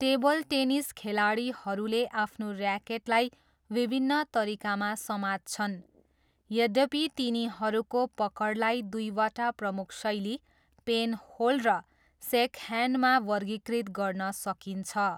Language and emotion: Nepali, neutral